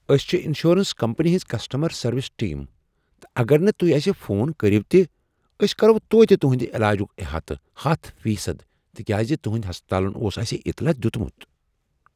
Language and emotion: Kashmiri, surprised